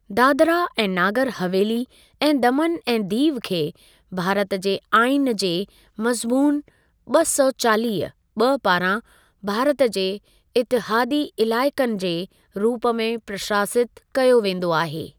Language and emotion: Sindhi, neutral